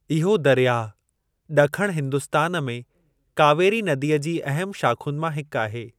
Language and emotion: Sindhi, neutral